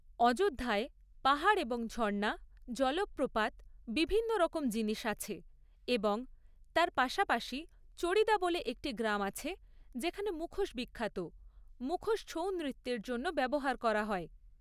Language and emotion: Bengali, neutral